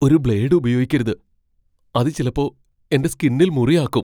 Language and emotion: Malayalam, fearful